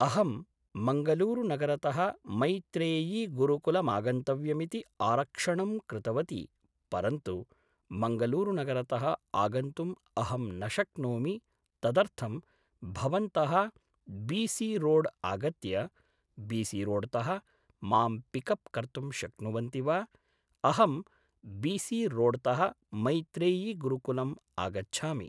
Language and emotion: Sanskrit, neutral